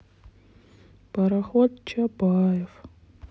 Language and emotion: Russian, sad